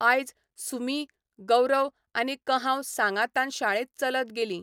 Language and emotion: Goan Konkani, neutral